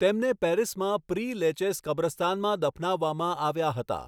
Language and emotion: Gujarati, neutral